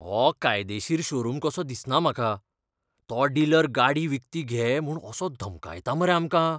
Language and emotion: Goan Konkani, fearful